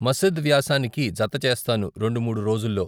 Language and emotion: Telugu, neutral